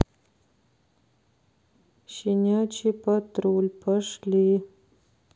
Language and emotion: Russian, sad